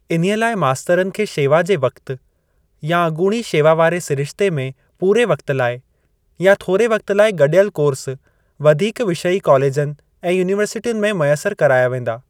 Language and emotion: Sindhi, neutral